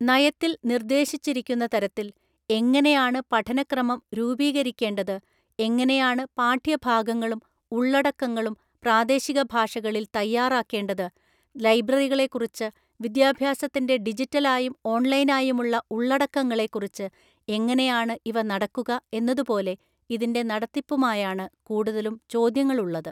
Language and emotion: Malayalam, neutral